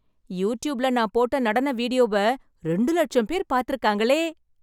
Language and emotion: Tamil, happy